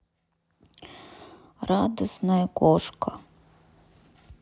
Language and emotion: Russian, sad